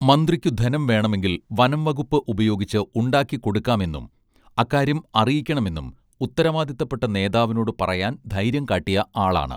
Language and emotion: Malayalam, neutral